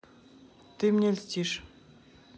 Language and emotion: Russian, neutral